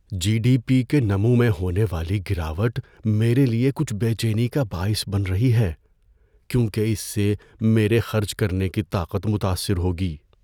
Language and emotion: Urdu, fearful